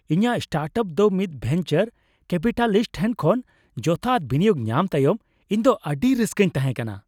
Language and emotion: Santali, happy